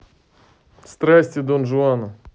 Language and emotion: Russian, neutral